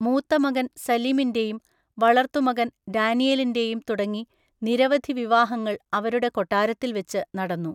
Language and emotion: Malayalam, neutral